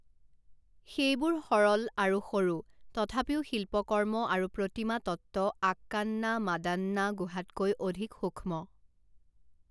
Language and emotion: Assamese, neutral